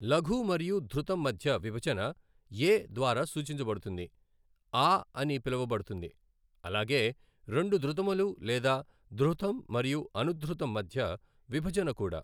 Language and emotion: Telugu, neutral